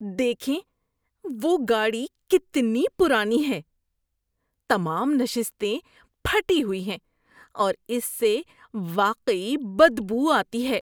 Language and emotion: Urdu, disgusted